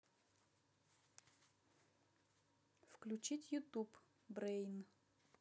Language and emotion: Russian, neutral